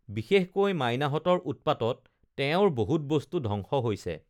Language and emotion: Assamese, neutral